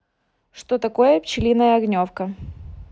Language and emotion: Russian, neutral